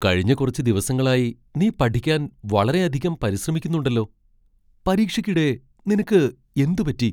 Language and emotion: Malayalam, surprised